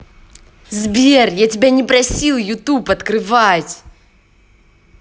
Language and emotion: Russian, angry